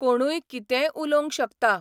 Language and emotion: Goan Konkani, neutral